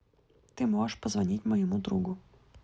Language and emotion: Russian, neutral